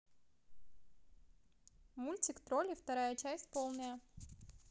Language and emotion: Russian, neutral